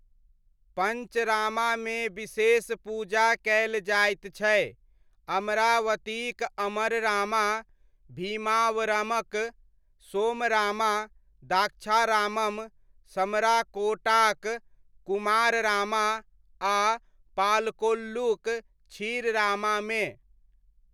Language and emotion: Maithili, neutral